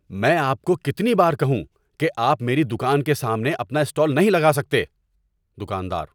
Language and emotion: Urdu, angry